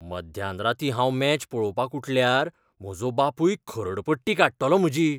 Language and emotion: Goan Konkani, fearful